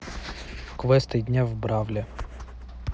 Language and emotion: Russian, neutral